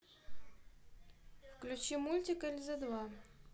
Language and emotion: Russian, neutral